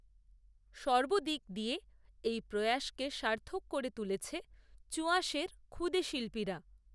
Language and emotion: Bengali, neutral